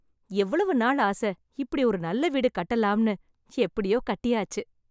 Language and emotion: Tamil, happy